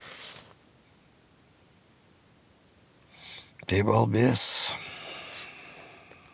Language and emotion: Russian, neutral